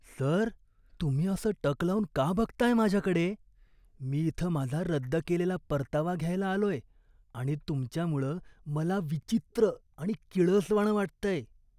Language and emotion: Marathi, disgusted